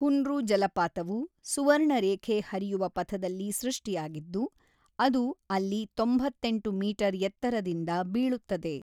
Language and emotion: Kannada, neutral